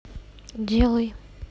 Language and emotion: Russian, neutral